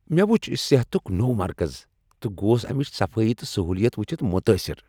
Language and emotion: Kashmiri, happy